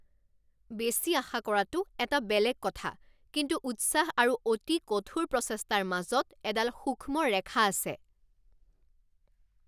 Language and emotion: Assamese, angry